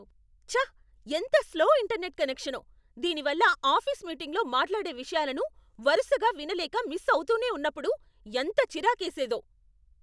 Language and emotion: Telugu, angry